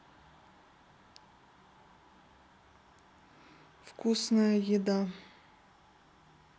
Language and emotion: Russian, neutral